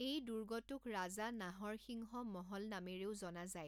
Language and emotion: Assamese, neutral